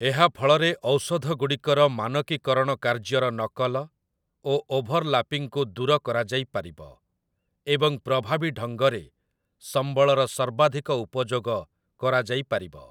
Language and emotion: Odia, neutral